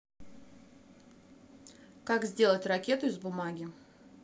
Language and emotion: Russian, neutral